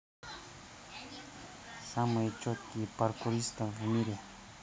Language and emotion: Russian, neutral